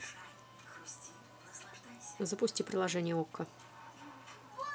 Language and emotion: Russian, neutral